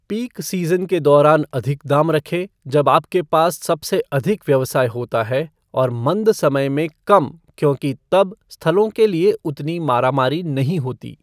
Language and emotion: Hindi, neutral